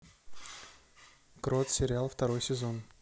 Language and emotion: Russian, neutral